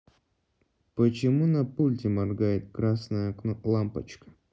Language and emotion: Russian, neutral